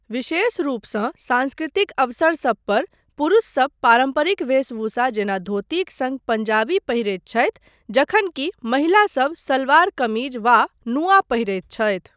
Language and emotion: Maithili, neutral